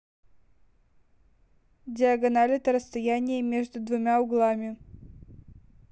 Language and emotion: Russian, neutral